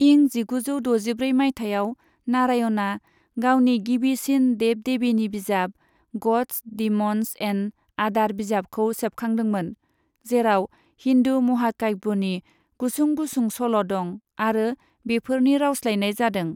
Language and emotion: Bodo, neutral